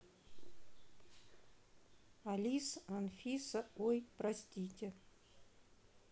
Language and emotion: Russian, neutral